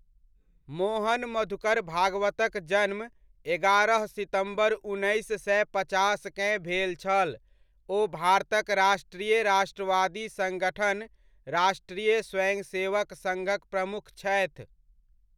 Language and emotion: Maithili, neutral